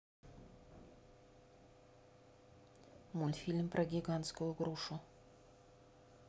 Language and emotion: Russian, neutral